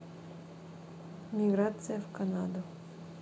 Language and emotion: Russian, neutral